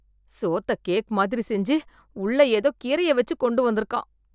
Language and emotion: Tamil, disgusted